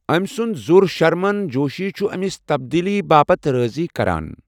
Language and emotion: Kashmiri, neutral